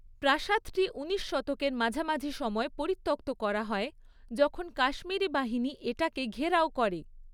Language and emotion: Bengali, neutral